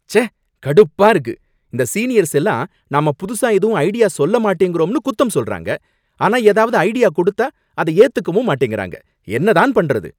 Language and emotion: Tamil, angry